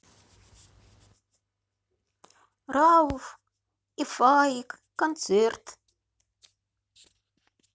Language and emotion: Russian, neutral